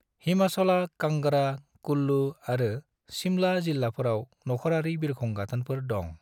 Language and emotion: Bodo, neutral